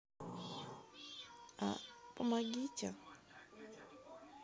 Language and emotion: Russian, sad